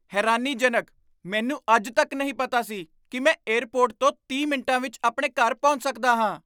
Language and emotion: Punjabi, surprised